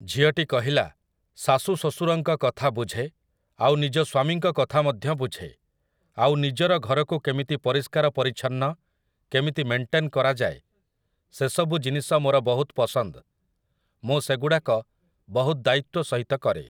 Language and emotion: Odia, neutral